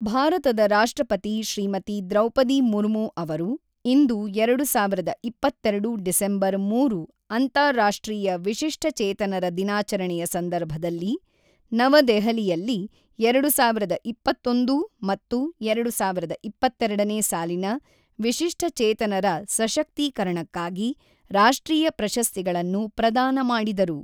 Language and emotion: Kannada, neutral